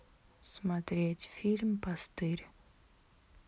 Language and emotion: Russian, neutral